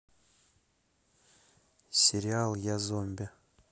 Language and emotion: Russian, neutral